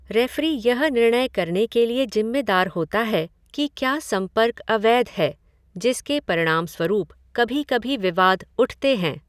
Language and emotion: Hindi, neutral